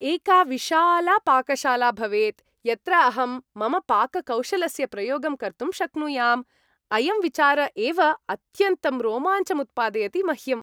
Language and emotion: Sanskrit, happy